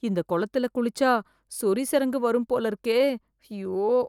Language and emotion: Tamil, fearful